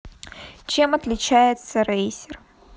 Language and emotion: Russian, neutral